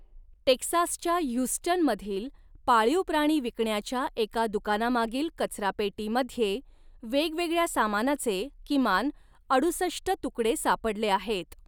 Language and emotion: Marathi, neutral